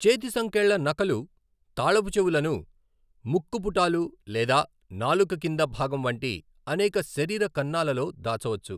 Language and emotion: Telugu, neutral